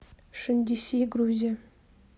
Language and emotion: Russian, neutral